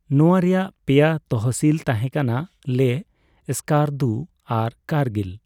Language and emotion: Santali, neutral